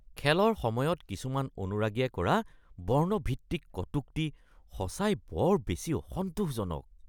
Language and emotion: Assamese, disgusted